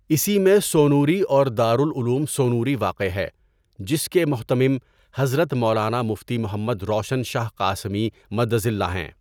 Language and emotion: Urdu, neutral